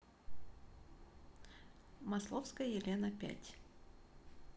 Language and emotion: Russian, neutral